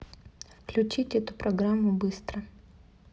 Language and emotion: Russian, neutral